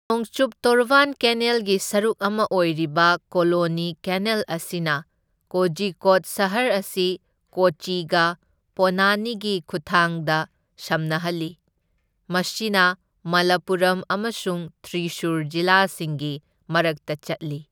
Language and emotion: Manipuri, neutral